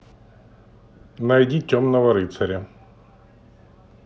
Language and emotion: Russian, neutral